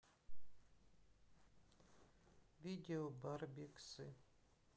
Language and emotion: Russian, sad